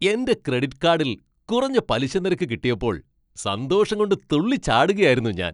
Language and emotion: Malayalam, happy